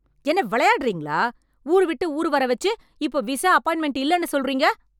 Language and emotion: Tamil, angry